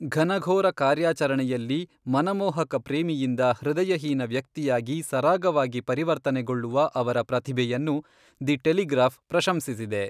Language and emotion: Kannada, neutral